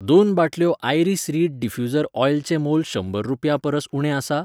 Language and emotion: Goan Konkani, neutral